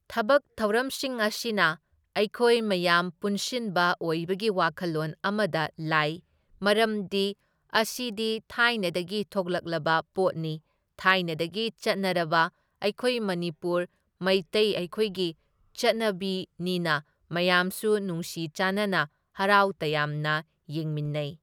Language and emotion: Manipuri, neutral